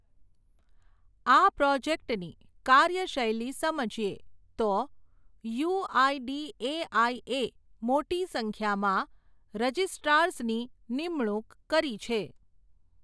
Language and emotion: Gujarati, neutral